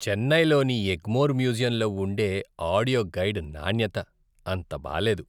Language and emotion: Telugu, disgusted